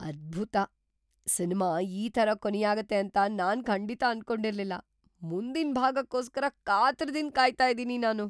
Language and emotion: Kannada, surprised